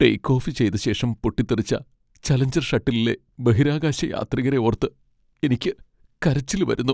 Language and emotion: Malayalam, sad